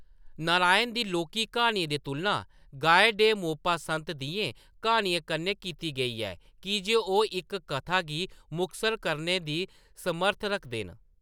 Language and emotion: Dogri, neutral